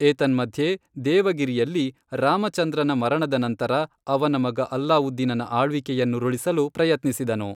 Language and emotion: Kannada, neutral